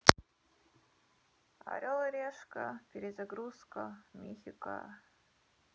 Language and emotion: Russian, sad